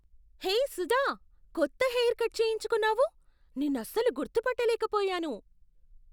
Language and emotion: Telugu, surprised